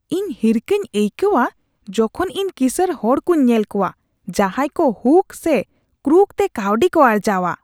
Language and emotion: Santali, disgusted